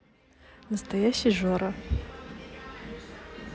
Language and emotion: Russian, neutral